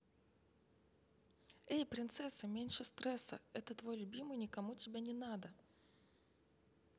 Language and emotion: Russian, neutral